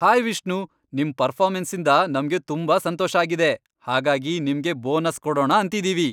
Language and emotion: Kannada, happy